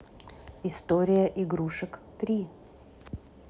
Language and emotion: Russian, neutral